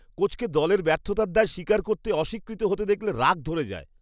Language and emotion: Bengali, disgusted